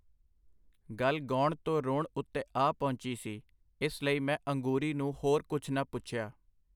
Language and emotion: Punjabi, neutral